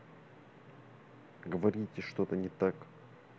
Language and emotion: Russian, neutral